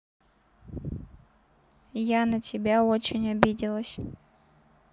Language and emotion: Russian, neutral